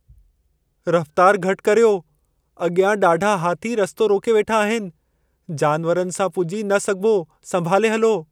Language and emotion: Sindhi, fearful